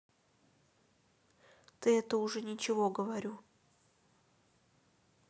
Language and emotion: Russian, neutral